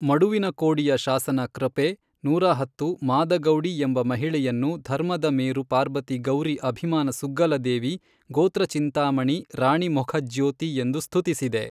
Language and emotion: Kannada, neutral